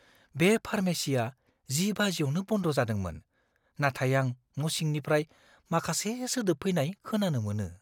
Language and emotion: Bodo, fearful